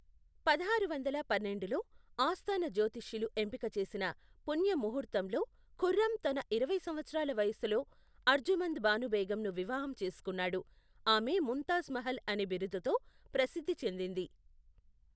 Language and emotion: Telugu, neutral